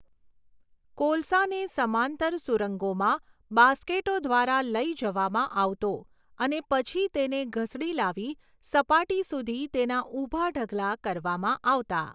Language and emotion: Gujarati, neutral